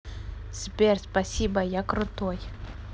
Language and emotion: Russian, neutral